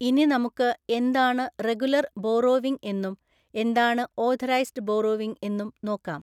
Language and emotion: Malayalam, neutral